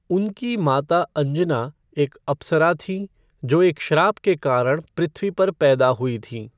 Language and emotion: Hindi, neutral